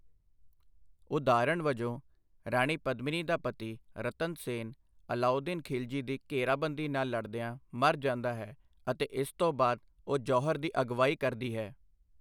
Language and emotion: Punjabi, neutral